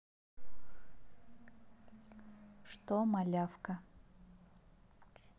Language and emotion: Russian, neutral